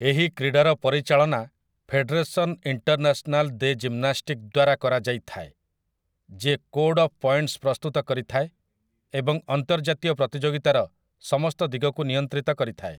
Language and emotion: Odia, neutral